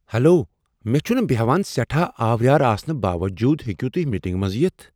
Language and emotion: Kashmiri, surprised